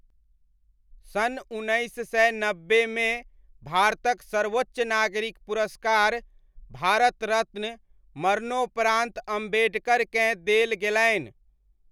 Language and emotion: Maithili, neutral